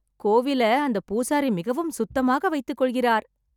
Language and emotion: Tamil, happy